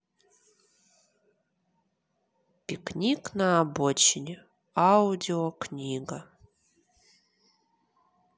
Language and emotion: Russian, neutral